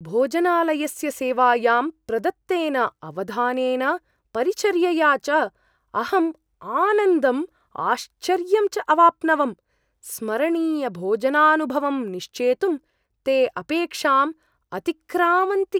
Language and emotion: Sanskrit, surprised